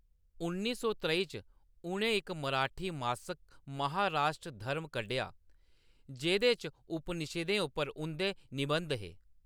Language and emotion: Dogri, neutral